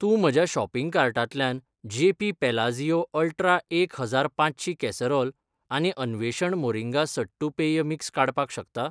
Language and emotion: Goan Konkani, neutral